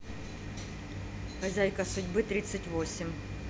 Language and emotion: Russian, neutral